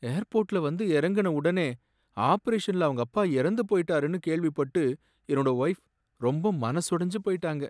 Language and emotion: Tamil, sad